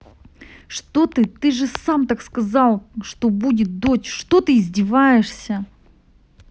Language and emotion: Russian, angry